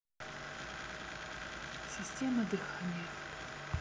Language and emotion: Russian, neutral